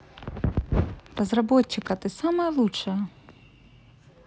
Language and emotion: Russian, positive